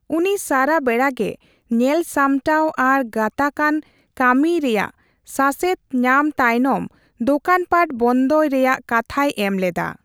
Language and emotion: Santali, neutral